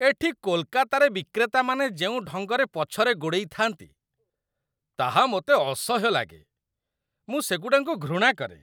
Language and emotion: Odia, disgusted